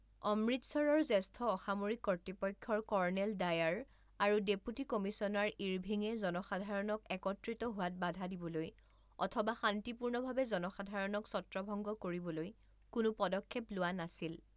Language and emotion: Assamese, neutral